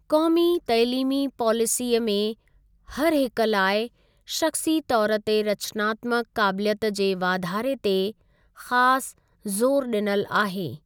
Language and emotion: Sindhi, neutral